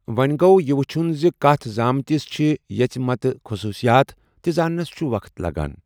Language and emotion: Kashmiri, neutral